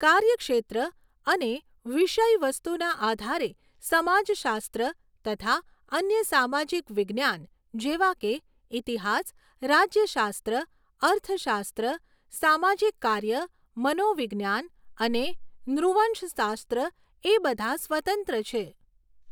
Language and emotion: Gujarati, neutral